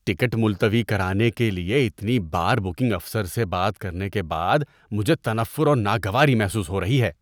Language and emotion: Urdu, disgusted